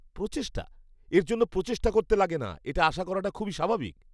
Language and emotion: Bengali, disgusted